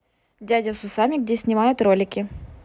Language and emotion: Russian, neutral